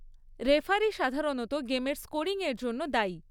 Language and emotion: Bengali, neutral